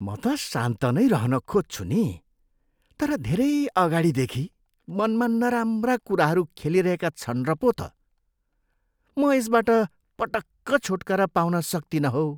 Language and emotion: Nepali, disgusted